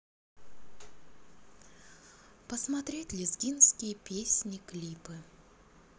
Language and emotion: Russian, neutral